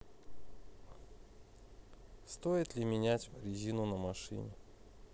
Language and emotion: Russian, neutral